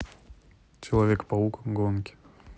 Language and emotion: Russian, neutral